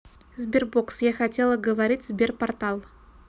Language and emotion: Russian, neutral